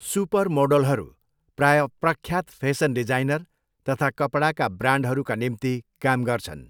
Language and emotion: Nepali, neutral